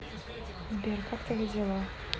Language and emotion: Russian, neutral